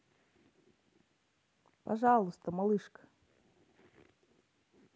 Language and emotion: Russian, neutral